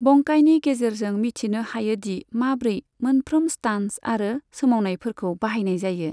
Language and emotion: Bodo, neutral